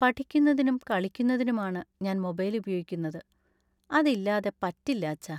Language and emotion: Malayalam, sad